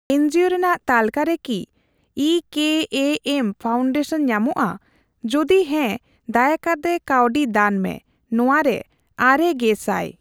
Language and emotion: Santali, neutral